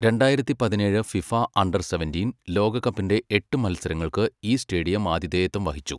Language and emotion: Malayalam, neutral